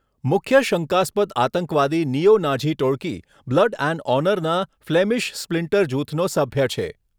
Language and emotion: Gujarati, neutral